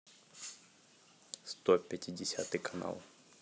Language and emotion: Russian, neutral